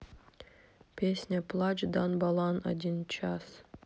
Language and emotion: Russian, neutral